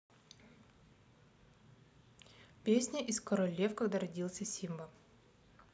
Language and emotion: Russian, neutral